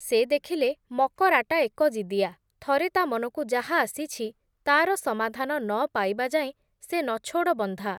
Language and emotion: Odia, neutral